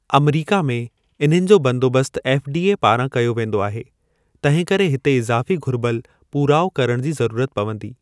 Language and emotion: Sindhi, neutral